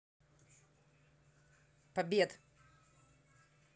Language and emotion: Russian, neutral